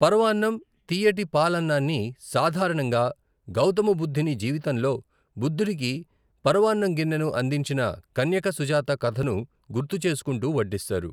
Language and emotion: Telugu, neutral